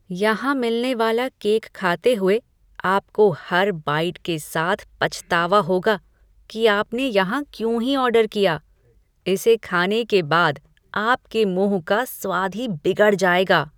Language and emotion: Hindi, disgusted